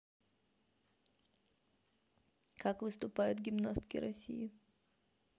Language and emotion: Russian, neutral